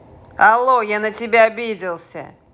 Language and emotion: Russian, angry